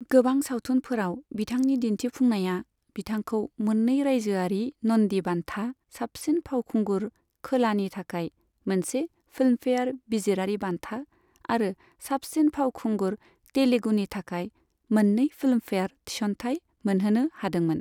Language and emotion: Bodo, neutral